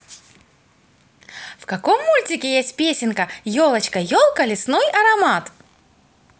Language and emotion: Russian, positive